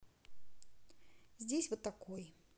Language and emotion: Russian, neutral